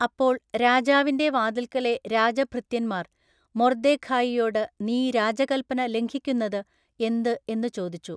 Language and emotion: Malayalam, neutral